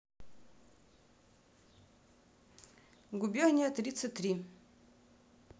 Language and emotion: Russian, neutral